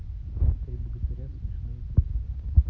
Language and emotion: Russian, neutral